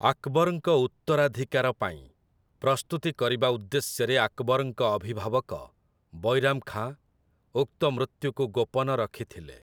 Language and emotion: Odia, neutral